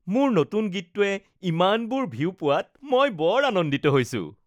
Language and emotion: Assamese, happy